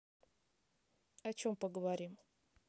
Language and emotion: Russian, neutral